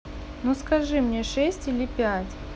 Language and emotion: Russian, neutral